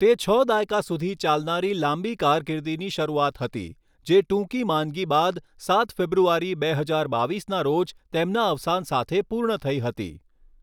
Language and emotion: Gujarati, neutral